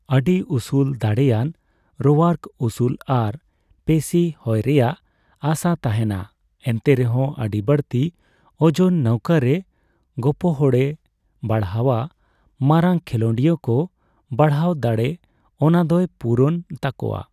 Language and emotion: Santali, neutral